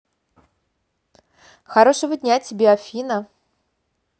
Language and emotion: Russian, positive